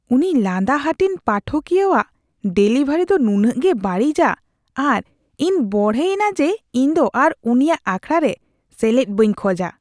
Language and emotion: Santali, disgusted